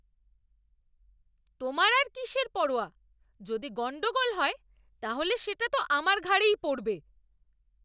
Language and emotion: Bengali, angry